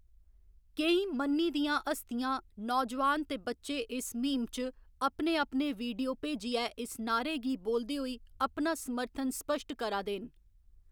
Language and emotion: Dogri, neutral